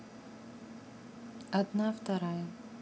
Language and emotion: Russian, neutral